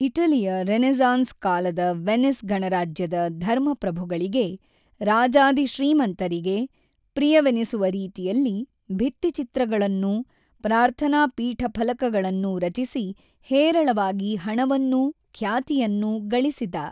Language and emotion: Kannada, neutral